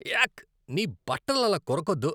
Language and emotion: Telugu, disgusted